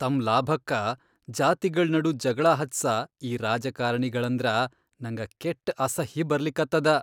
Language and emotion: Kannada, disgusted